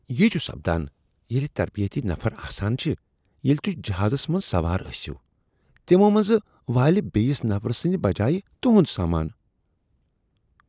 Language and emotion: Kashmiri, disgusted